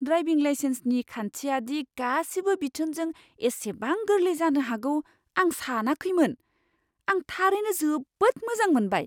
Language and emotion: Bodo, surprised